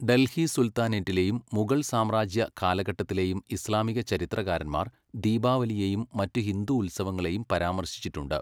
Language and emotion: Malayalam, neutral